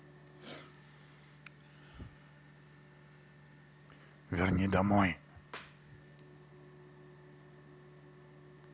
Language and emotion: Russian, neutral